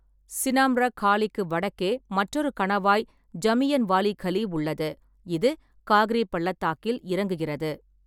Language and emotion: Tamil, neutral